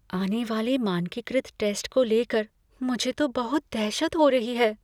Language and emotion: Hindi, fearful